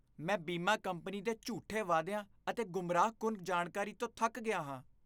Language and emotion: Punjabi, disgusted